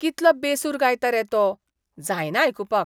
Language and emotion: Goan Konkani, disgusted